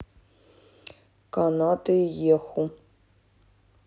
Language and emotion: Russian, neutral